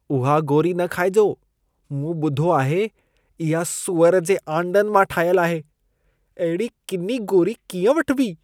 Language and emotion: Sindhi, disgusted